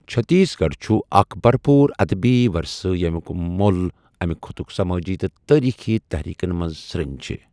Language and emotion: Kashmiri, neutral